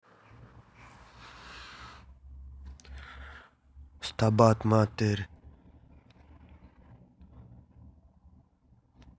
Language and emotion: Russian, neutral